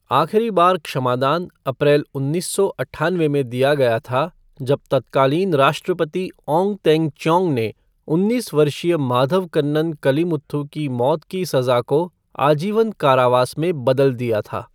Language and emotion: Hindi, neutral